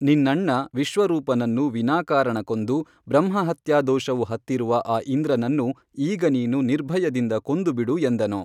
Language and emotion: Kannada, neutral